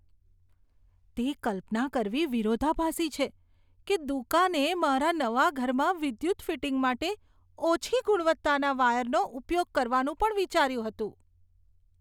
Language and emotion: Gujarati, disgusted